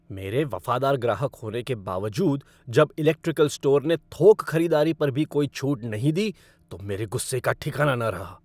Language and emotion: Hindi, angry